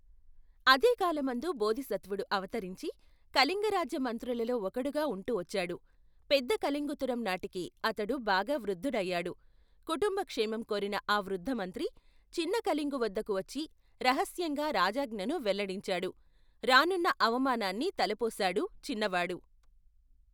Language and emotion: Telugu, neutral